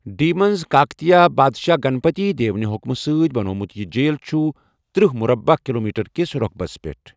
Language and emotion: Kashmiri, neutral